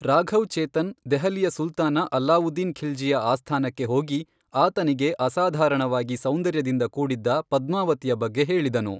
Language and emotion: Kannada, neutral